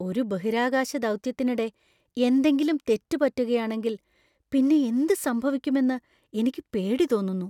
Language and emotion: Malayalam, fearful